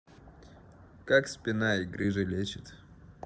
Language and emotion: Russian, neutral